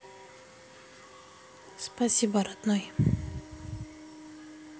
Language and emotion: Russian, sad